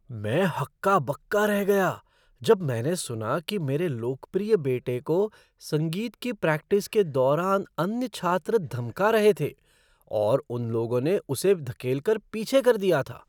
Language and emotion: Hindi, surprised